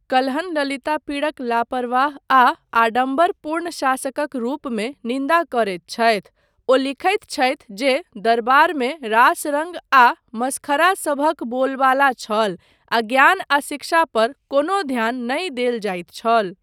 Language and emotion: Maithili, neutral